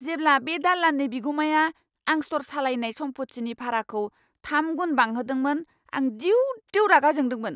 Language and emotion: Bodo, angry